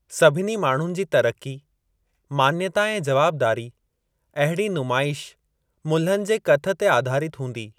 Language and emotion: Sindhi, neutral